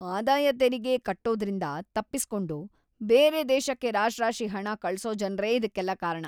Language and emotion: Kannada, disgusted